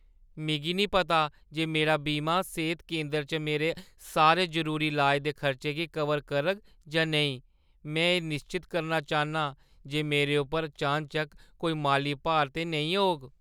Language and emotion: Dogri, fearful